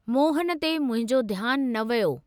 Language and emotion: Sindhi, neutral